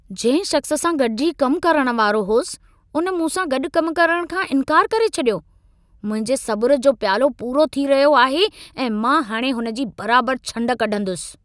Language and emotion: Sindhi, angry